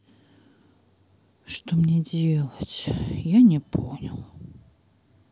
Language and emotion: Russian, sad